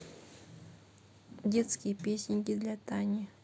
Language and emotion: Russian, neutral